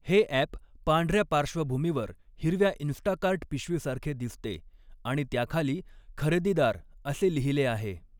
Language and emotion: Marathi, neutral